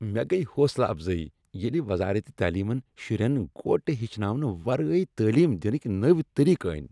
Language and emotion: Kashmiri, happy